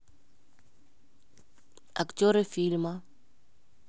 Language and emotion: Russian, neutral